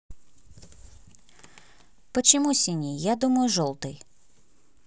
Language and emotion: Russian, neutral